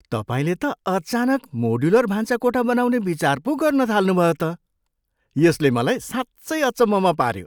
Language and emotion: Nepali, surprised